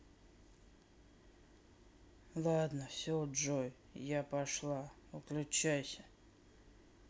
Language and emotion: Russian, sad